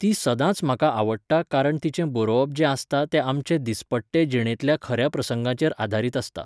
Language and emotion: Goan Konkani, neutral